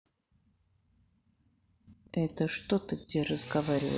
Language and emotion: Russian, angry